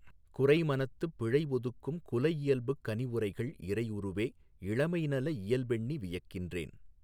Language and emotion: Tamil, neutral